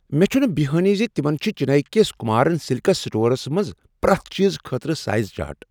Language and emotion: Kashmiri, surprised